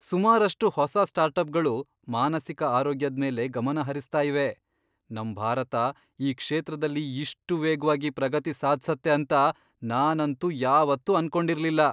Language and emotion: Kannada, surprised